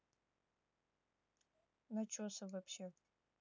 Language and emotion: Russian, neutral